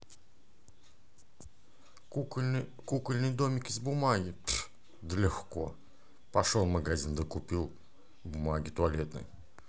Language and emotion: Russian, positive